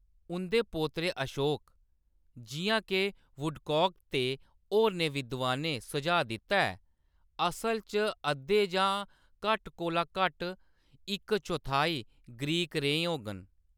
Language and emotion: Dogri, neutral